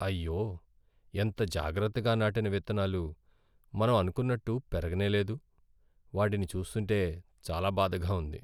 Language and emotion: Telugu, sad